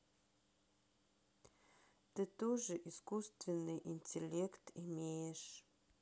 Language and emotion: Russian, sad